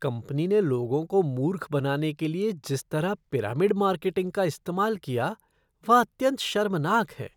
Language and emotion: Hindi, disgusted